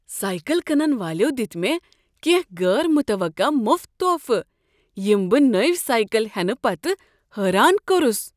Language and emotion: Kashmiri, surprised